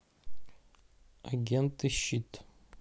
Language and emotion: Russian, neutral